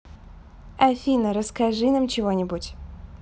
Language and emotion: Russian, neutral